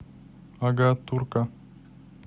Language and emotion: Russian, neutral